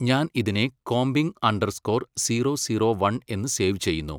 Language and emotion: Malayalam, neutral